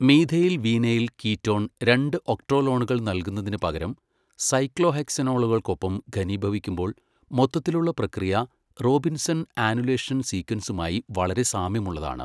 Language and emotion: Malayalam, neutral